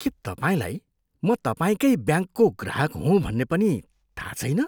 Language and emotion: Nepali, disgusted